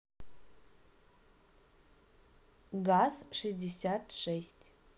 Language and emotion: Russian, neutral